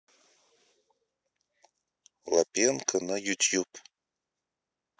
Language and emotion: Russian, neutral